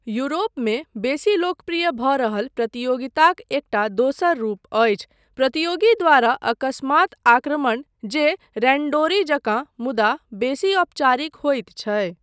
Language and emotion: Maithili, neutral